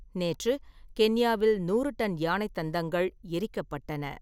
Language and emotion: Tamil, neutral